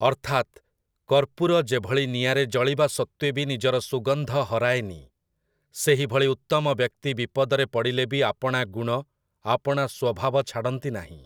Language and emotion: Odia, neutral